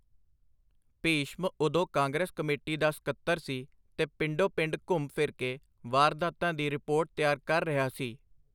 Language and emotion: Punjabi, neutral